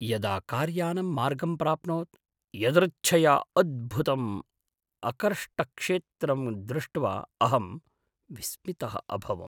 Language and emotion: Sanskrit, surprised